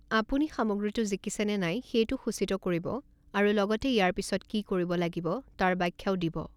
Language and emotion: Assamese, neutral